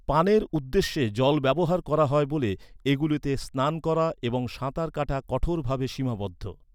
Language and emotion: Bengali, neutral